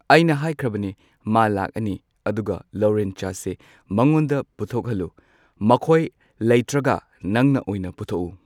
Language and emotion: Manipuri, neutral